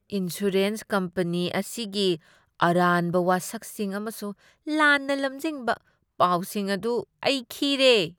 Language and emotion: Manipuri, disgusted